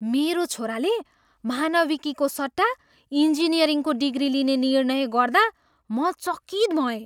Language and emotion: Nepali, surprised